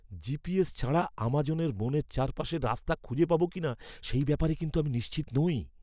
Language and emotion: Bengali, fearful